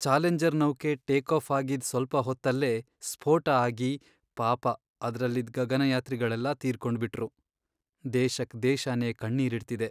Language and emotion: Kannada, sad